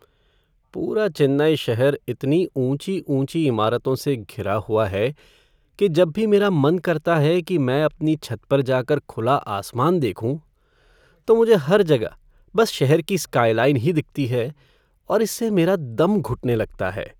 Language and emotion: Hindi, sad